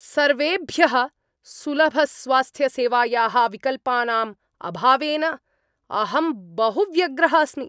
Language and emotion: Sanskrit, angry